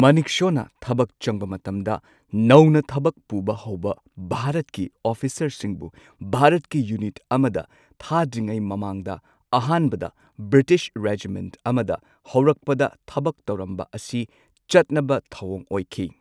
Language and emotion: Manipuri, neutral